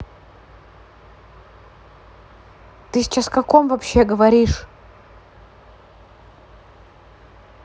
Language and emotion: Russian, neutral